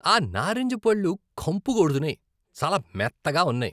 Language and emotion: Telugu, disgusted